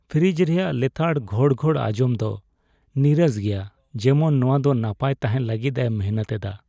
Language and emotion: Santali, sad